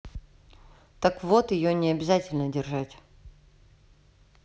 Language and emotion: Russian, neutral